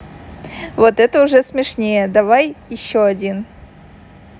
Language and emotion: Russian, positive